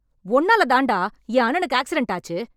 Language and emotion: Tamil, angry